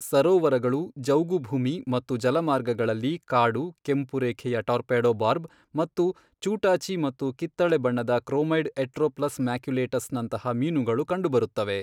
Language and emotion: Kannada, neutral